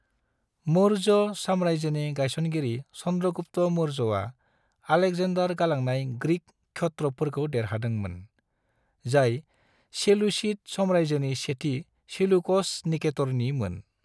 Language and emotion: Bodo, neutral